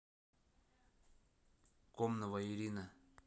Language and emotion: Russian, neutral